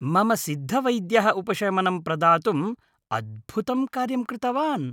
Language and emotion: Sanskrit, happy